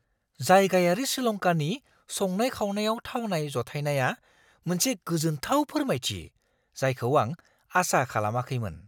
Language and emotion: Bodo, surprised